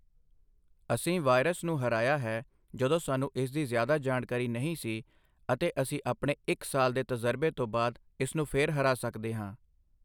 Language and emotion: Punjabi, neutral